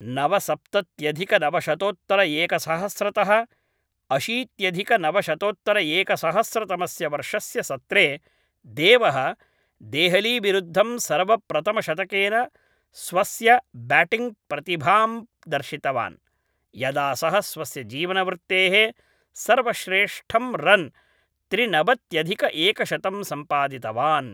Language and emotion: Sanskrit, neutral